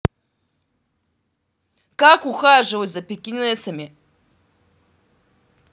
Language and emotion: Russian, angry